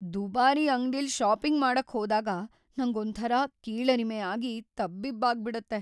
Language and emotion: Kannada, fearful